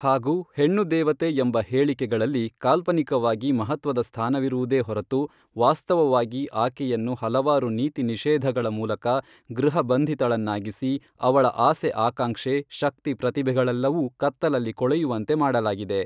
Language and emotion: Kannada, neutral